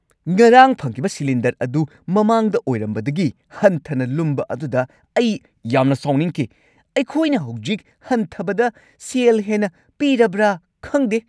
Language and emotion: Manipuri, angry